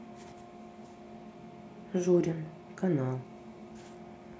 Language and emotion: Russian, neutral